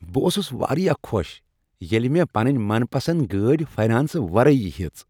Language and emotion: Kashmiri, happy